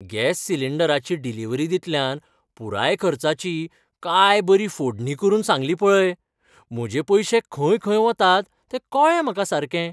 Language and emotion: Goan Konkani, happy